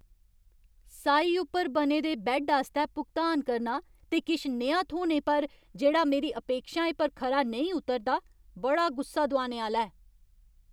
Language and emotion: Dogri, angry